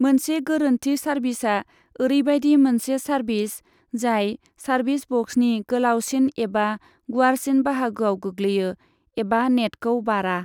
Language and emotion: Bodo, neutral